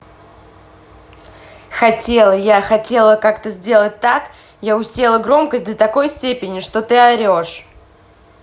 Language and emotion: Russian, angry